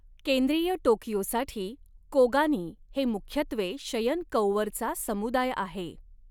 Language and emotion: Marathi, neutral